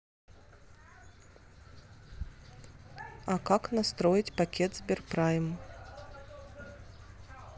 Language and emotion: Russian, neutral